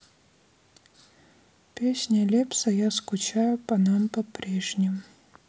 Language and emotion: Russian, sad